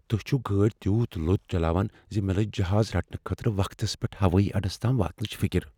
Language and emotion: Kashmiri, fearful